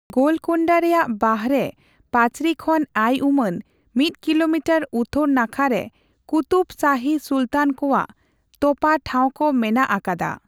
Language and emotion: Santali, neutral